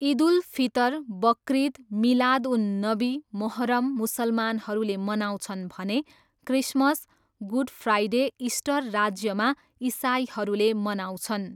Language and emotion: Nepali, neutral